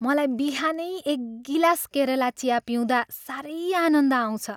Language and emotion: Nepali, happy